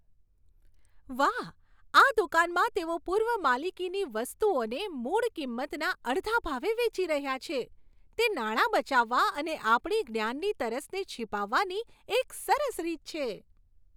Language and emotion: Gujarati, happy